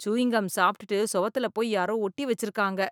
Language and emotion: Tamil, disgusted